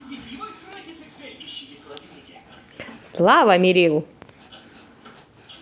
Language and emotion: Russian, positive